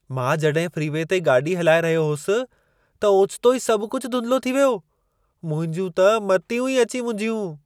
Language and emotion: Sindhi, surprised